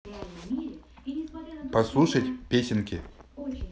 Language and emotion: Russian, neutral